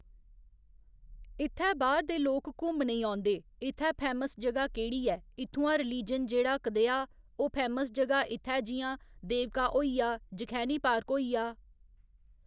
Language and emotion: Dogri, neutral